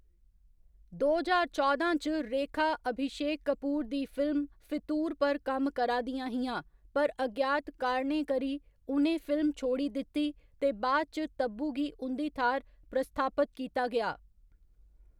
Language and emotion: Dogri, neutral